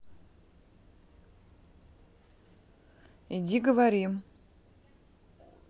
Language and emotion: Russian, neutral